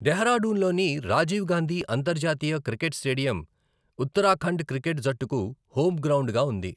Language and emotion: Telugu, neutral